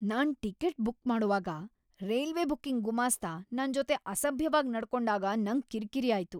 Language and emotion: Kannada, angry